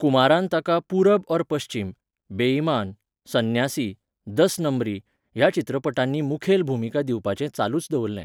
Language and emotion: Goan Konkani, neutral